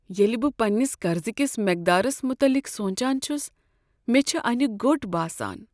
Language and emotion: Kashmiri, sad